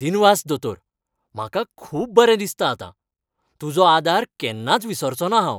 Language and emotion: Goan Konkani, happy